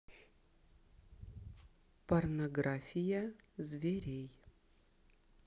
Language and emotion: Russian, neutral